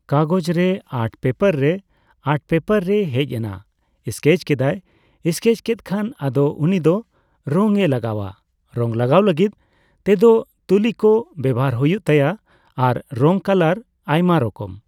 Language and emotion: Santali, neutral